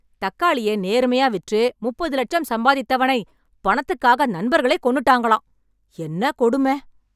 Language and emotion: Tamil, angry